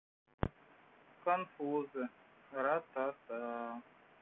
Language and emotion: Russian, neutral